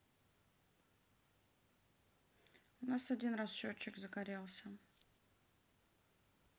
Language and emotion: Russian, neutral